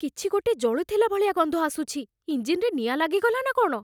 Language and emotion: Odia, fearful